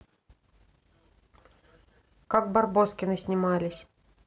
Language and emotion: Russian, neutral